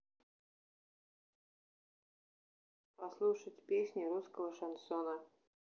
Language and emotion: Russian, neutral